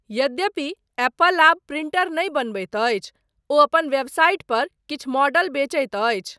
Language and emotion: Maithili, neutral